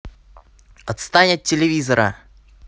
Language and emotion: Russian, angry